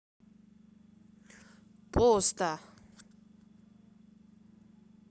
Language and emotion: Russian, neutral